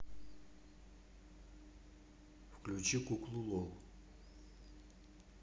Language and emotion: Russian, neutral